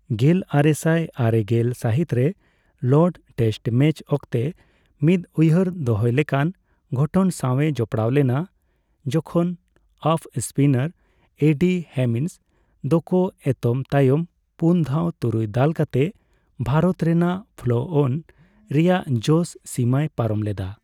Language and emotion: Santali, neutral